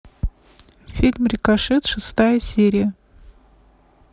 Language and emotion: Russian, neutral